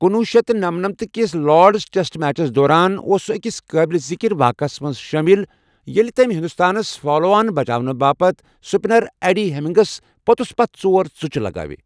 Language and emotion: Kashmiri, neutral